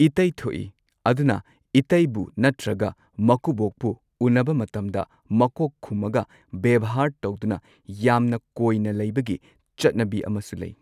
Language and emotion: Manipuri, neutral